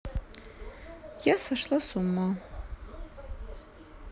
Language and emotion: Russian, sad